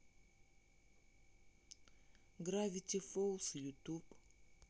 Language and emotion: Russian, neutral